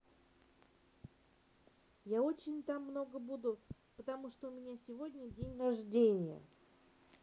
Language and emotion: Russian, positive